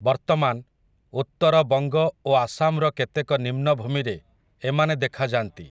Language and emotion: Odia, neutral